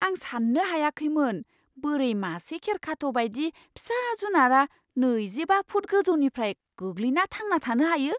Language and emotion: Bodo, surprised